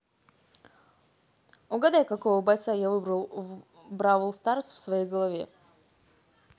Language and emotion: Russian, positive